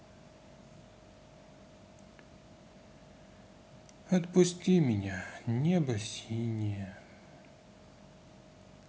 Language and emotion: Russian, sad